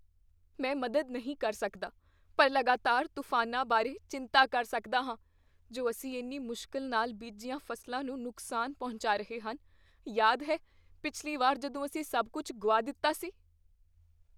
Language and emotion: Punjabi, fearful